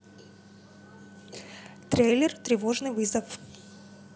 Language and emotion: Russian, neutral